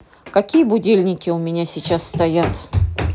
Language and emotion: Russian, angry